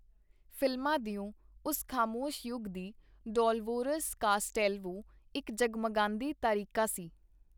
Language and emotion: Punjabi, neutral